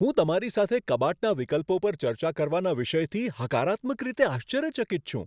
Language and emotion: Gujarati, surprised